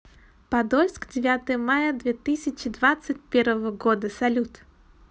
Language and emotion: Russian, positive